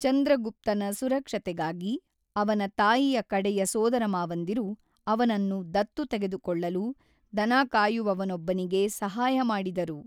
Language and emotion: Kannada, neutral